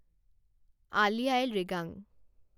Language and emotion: Assamese, neutral